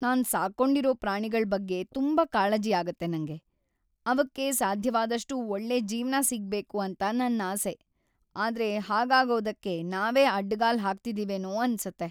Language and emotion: Kannada, sad